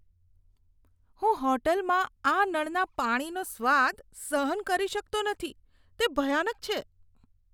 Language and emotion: Gujarati, disgusted